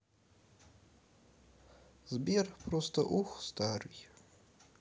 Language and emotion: Russian, sad